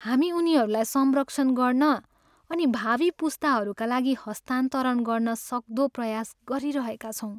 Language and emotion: Nepali, sad